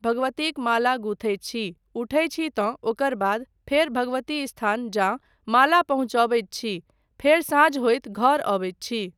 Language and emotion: Maithili, neutral